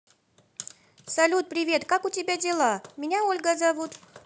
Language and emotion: Russian, positive